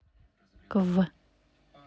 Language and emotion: Russian, neutral